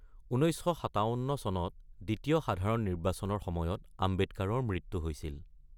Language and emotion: Assamese, neutral